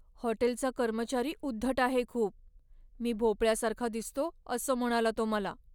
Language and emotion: Marathi, sad